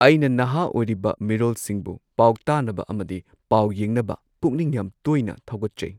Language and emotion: Manipuri, neutral